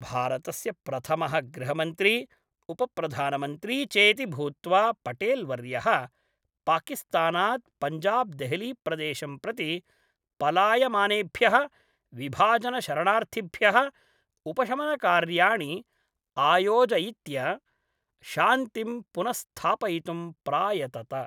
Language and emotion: Sanskrit, neutral